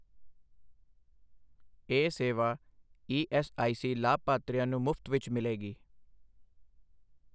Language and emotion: Punjabi, neutral